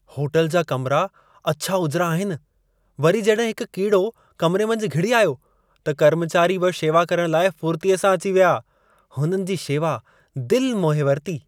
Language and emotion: Sindhi, happy